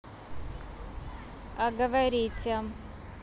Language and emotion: Russian, neutral